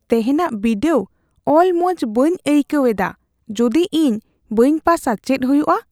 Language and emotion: Santali, fearful